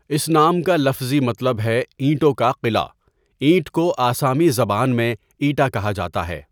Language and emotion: Urdu, neutral